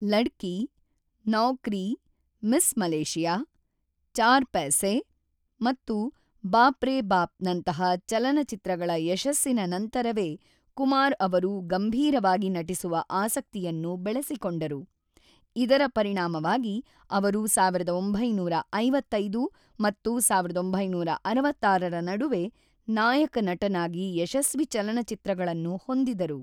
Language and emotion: Kannada, neutral